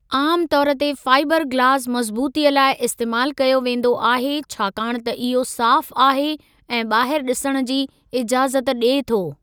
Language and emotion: Sindhi, neutral